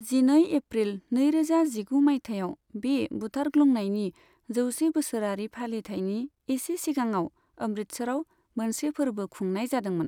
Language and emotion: Bodo, neutral